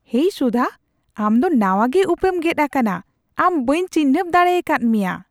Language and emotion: Santali, surprised